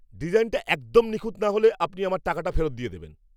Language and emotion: Bengali, angry